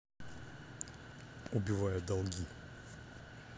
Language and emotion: Russian, neutral